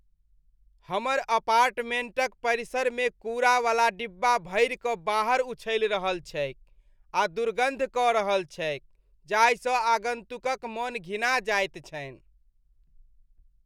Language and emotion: Maithili, disgusted